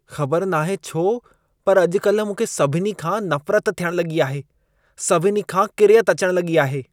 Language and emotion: Sindhi, disgusted